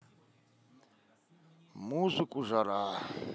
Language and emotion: Russian, neutral